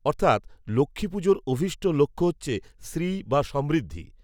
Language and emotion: Bengali, neutral